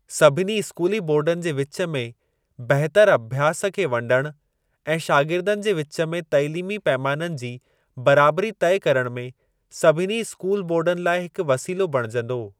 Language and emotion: Sindhi, neutral